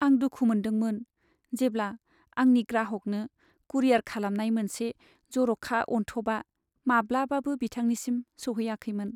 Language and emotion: Bodo, sad